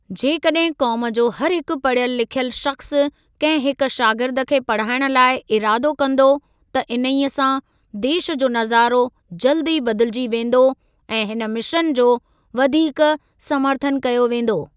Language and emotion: Sindhi, neutral